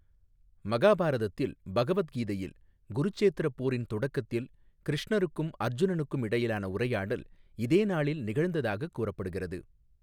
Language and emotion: Tamil, neutral